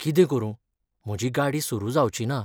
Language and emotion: Goan Konkani, sad